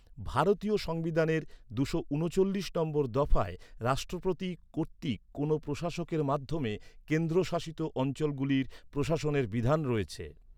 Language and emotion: Bengali, neutral